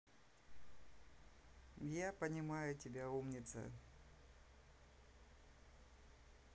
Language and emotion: Russian, sad